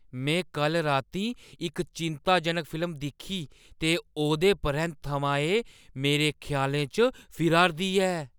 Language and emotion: Dogri, fearful